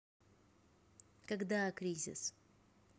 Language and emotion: Russian, neutral